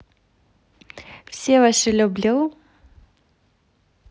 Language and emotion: Russian, positive